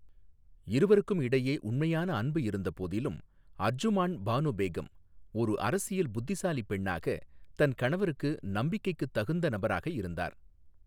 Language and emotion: Tamil, neutral